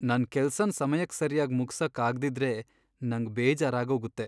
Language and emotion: Kannada, sad